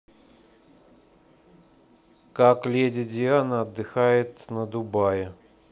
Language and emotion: Russian, neutral